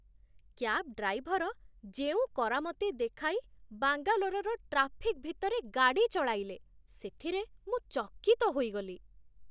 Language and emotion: Odia, surprised